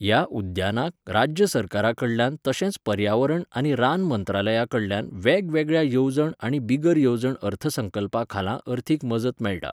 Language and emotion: Goan Konkani, neutral